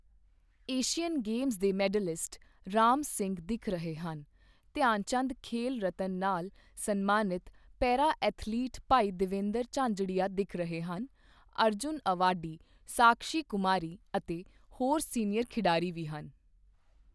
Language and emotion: Punjabi, neutral